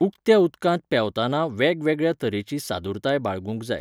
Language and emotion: Goan Konkani, neutral